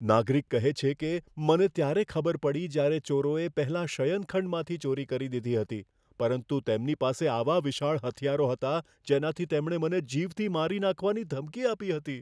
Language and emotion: Gujarati, fearful